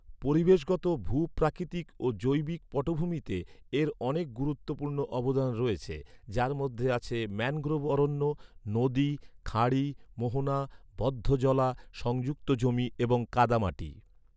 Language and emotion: Bengali, neutral